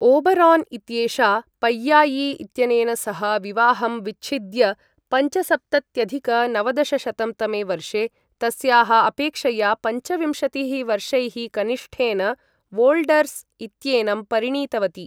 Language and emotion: Sanskrit, neutral